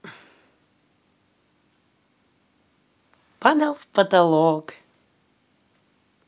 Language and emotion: Russian, positive